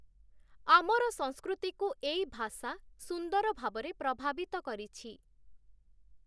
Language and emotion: Odia, neutral